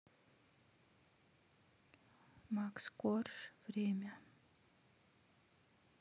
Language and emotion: Russian, neutral